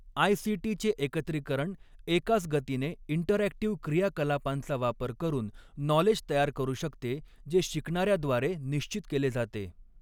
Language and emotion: Marathi, neutral